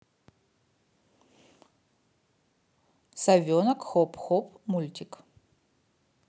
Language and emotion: Russian, neutral